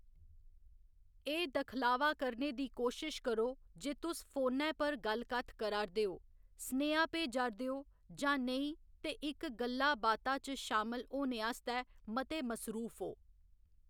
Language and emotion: Dogri, neutral